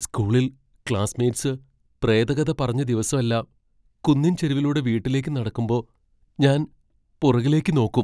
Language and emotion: Malayalam, fearful